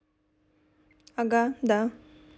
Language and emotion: Russian, neutral